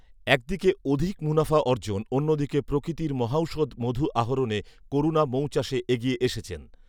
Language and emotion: Bengali, neutral